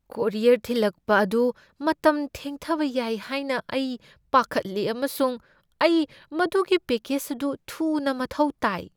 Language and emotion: Manipuri, fearful